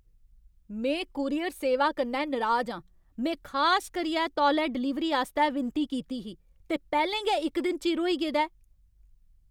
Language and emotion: Dogri, angry